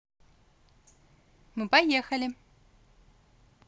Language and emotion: Russian, positive